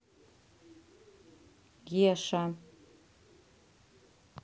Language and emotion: Russian, neutral